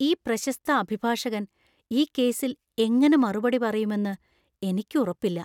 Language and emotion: Malayalam, fearful